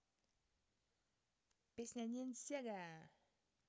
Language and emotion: Russian, positive